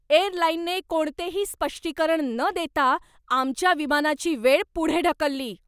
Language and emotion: Marathi, angry